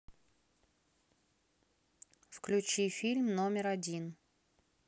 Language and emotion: Russian, neutral